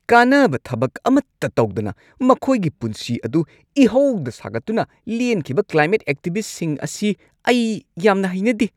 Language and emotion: Manipuri, angry